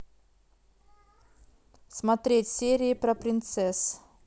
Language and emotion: Russian, neutral